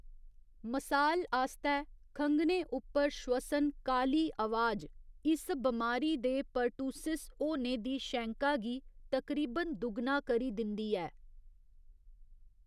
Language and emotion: Dogri, neutral